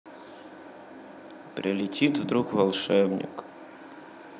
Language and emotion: Russian, sad